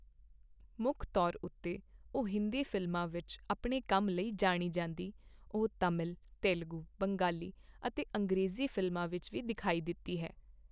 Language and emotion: Punjabi, neutral